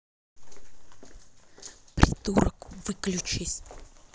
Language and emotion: Russian, angry